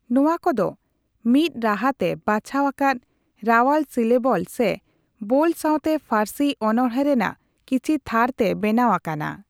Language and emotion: Santali, neutral